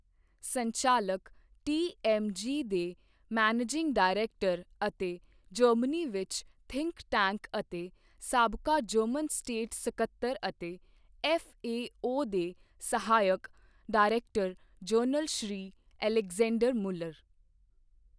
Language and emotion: Punjabi, neutral